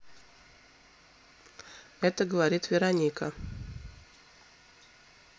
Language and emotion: Russian, neutral